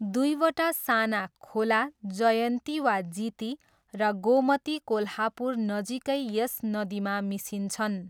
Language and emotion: Nepali, neutral